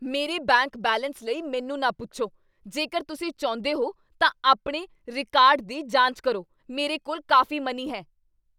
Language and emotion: Punjabi, angry